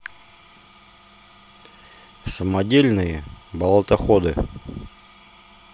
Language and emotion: Russian, neutral